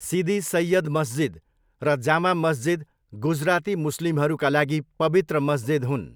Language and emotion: Nepali, neutral